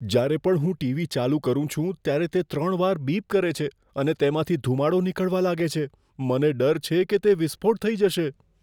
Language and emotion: Gujarati, fearful